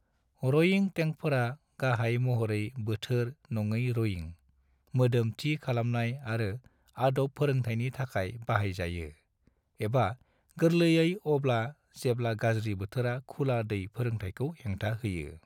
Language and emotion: Bodo, neutral